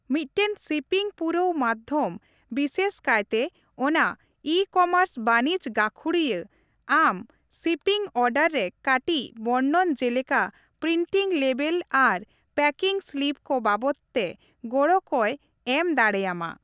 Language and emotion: Santali, neutral